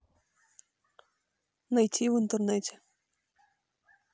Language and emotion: Russian, neutral